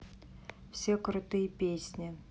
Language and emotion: Russian, neutral